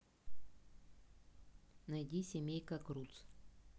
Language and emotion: Russian, neutral